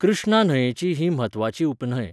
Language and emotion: Goan Konkani, neutral